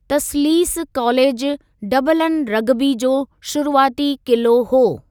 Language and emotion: Sindhi, neutral